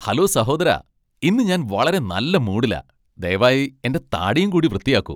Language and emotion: Malayalam, happy